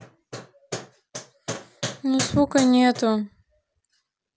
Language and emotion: Russian, sad